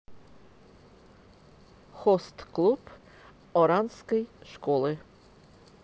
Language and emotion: Russian, neutral